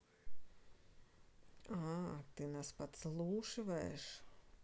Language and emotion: Russian, neutral